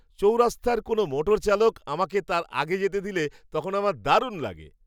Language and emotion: Bengali, happy